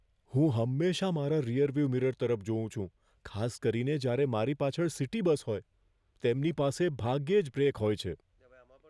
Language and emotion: Gujarati, fearful